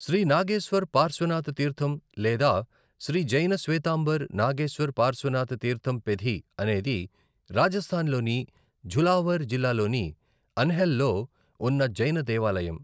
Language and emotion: Telugu, neutral